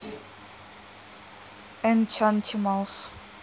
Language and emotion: Russian, neutral